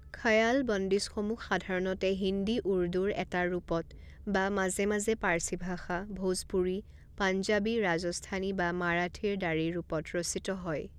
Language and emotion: Assamese, neutral